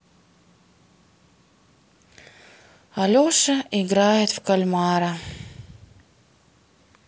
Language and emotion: Russian, sad